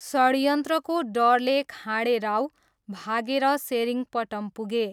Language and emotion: Nepali, neutral